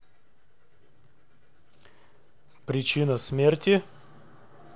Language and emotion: Russian, neutral